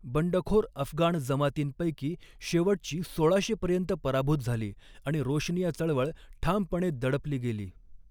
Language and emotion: Marathi, neutral